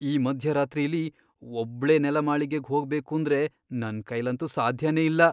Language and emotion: Kannada, fearful